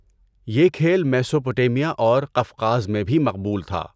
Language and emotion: Urdu, neutral